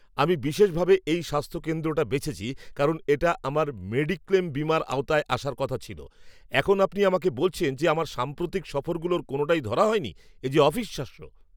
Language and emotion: Bengali, angry